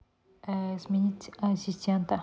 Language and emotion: Russian, neutral